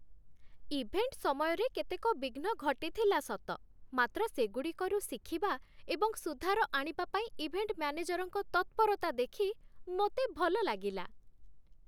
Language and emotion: Odia, happy